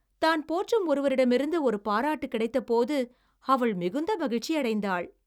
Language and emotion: Tamil, happy